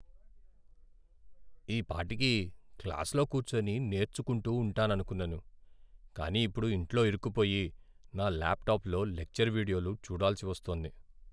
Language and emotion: Telugu, sad